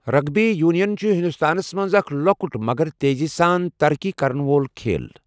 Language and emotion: Kashmiri, neutral